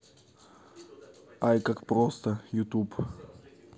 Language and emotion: Russian, neutral